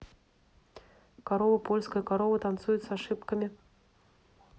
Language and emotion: Russian, neutral